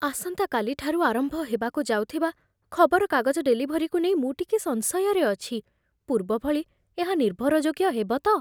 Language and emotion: Odia, fearful